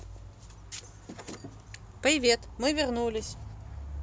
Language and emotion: Russian, positive